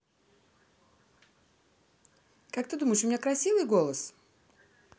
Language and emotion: Russian, neutral